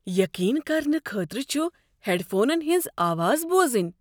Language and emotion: Kashmiri, surprised